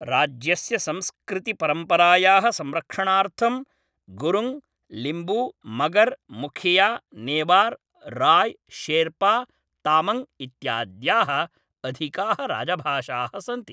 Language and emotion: Sanskrit, neutral